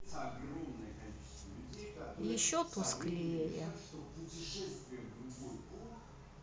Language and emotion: Russian, sad